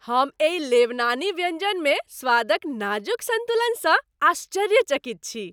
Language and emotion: Maithili, happy